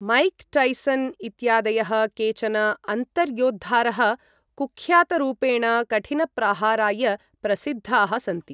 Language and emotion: Sanskrit, neutral